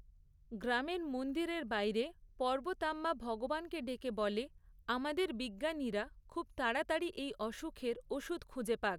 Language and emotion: Bengali, neutral